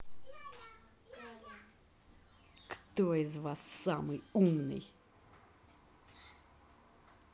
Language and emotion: Russian, neutral